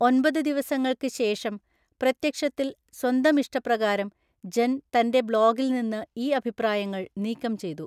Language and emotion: Malayalam, neutral